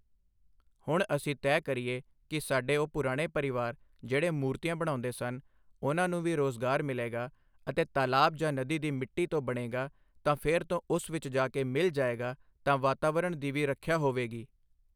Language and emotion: Punjabi, neutral